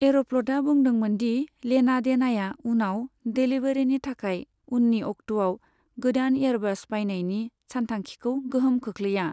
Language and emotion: Bodo, neutral